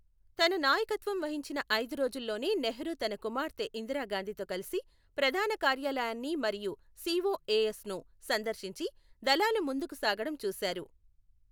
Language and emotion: Telugu, neutral